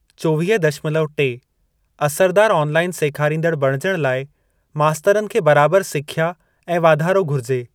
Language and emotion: Sindhi, neutral